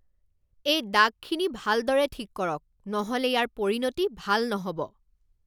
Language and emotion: Assamese, angry